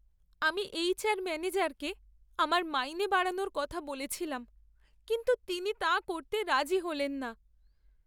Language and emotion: Bengali, sad